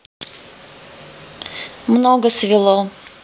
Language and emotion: Russian, neutral